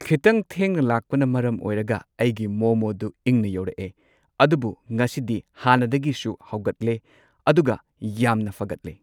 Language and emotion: Manipuri, neutral